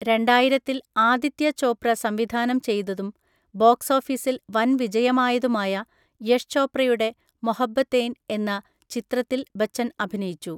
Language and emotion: Malayalam, neutral